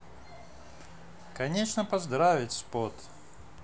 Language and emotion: Russian, positive